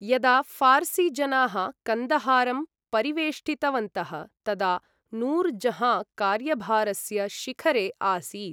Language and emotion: Sanskrit, neutral